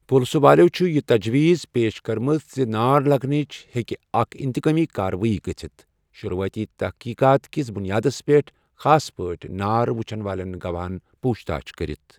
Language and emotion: Kashmiri, neutral